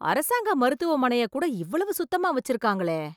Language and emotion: Tamil, surprised